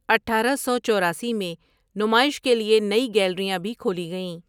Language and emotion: Urdu, neutral